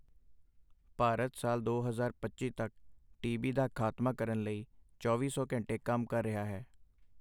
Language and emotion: Punjabi, neutral